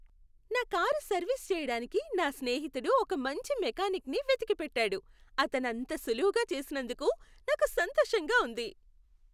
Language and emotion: Telugu, happy